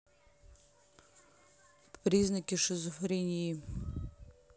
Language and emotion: Russian, neutral